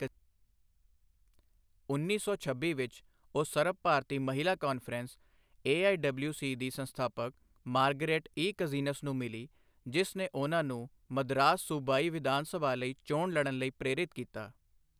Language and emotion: Punjabi, neutral